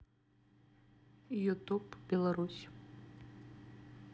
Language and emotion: Russian, neutral